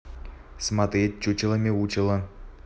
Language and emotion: Russian, neutral